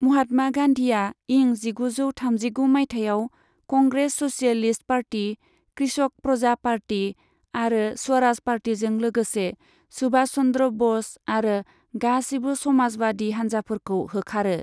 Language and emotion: Bodo, neutral